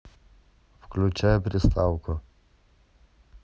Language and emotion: Russian, neutral